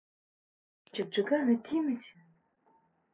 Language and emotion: Russian, neutral